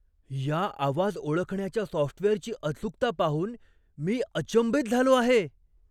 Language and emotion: Marathi, surprised